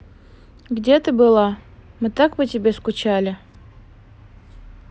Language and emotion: Russian, neutral